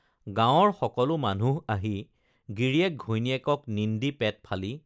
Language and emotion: Assamese, neutral